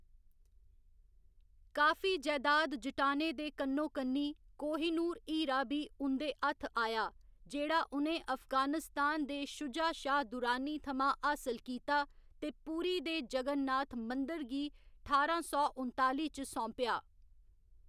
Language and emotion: Dogri, neutral